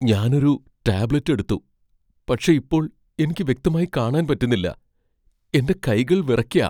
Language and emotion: Malayalam, fearful